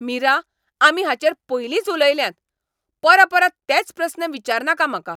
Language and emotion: Goan Konkani, angry